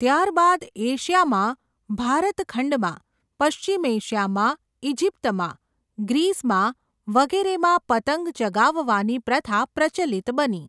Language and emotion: Gujarati, neutral